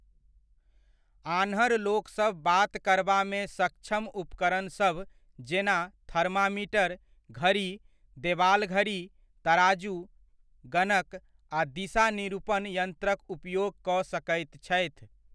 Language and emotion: Maithili, neutral